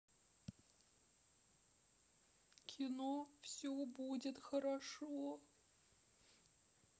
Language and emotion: Russian, sad